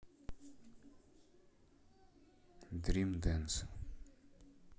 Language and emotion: Russian, neutral